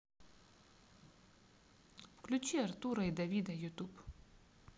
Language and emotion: Russian, sad